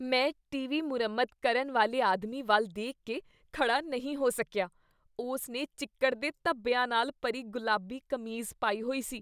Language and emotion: Punjabi, disgusted